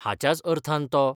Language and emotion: Goan Konkani, neutral